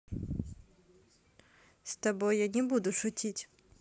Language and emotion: Russian, neutral